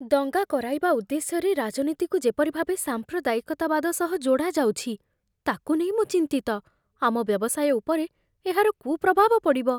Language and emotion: Odia, fearful